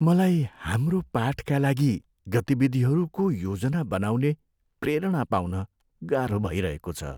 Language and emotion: Nepali, sad